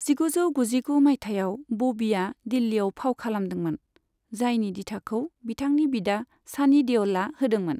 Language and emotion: Bodo, neutral